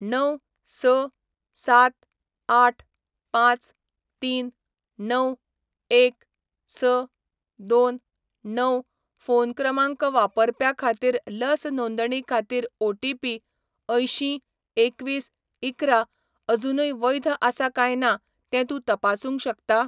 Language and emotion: Goan Konkani, neutral